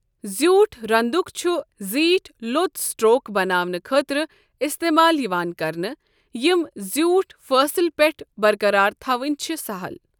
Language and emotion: Kashmiri, neutral